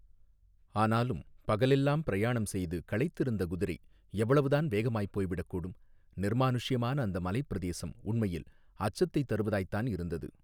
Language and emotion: Tamil, neutral